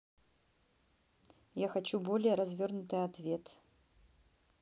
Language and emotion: Russian, neutral